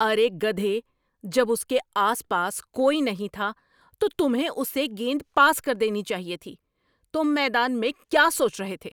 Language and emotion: Urdu, angry